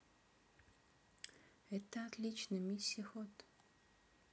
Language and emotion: Russian, neutral